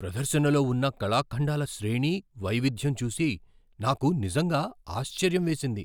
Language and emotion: Telugu, surprised